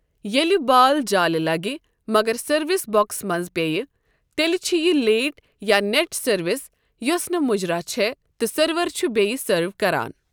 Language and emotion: Kashmiri, neutral